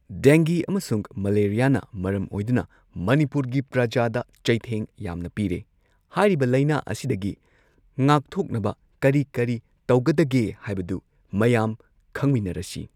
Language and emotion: Manipuri, neutral